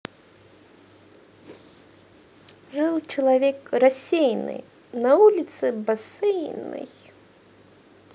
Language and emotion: Russian, positive